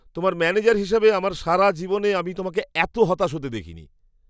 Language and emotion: Bengali, surprised